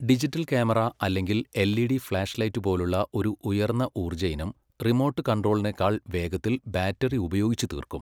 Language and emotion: Malayalam, neutral